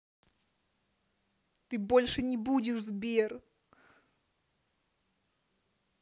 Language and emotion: Russian, angry